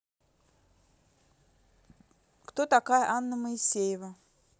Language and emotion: Russian, neutral